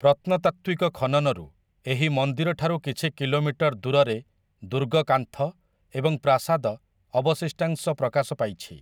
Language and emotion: Odia, neutral